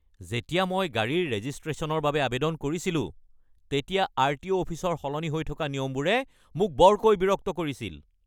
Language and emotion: Assamese, angry